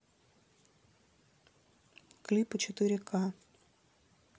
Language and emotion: Russian, neutral